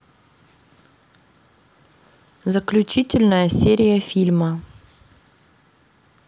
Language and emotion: Russian, neutral